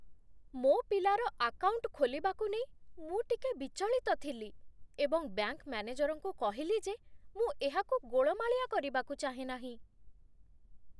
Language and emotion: Odia, fearful